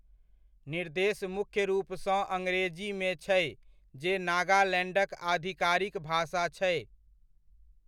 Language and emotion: Maithili, neutral